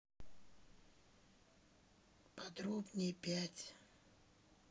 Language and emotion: Russian, neutral